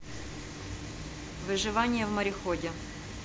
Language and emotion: Russian, neutral